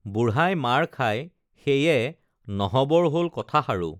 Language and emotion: Assamese, neutral